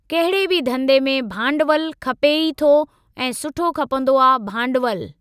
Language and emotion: Sindhi, neutral